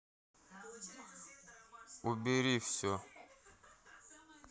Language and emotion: Russian, neutral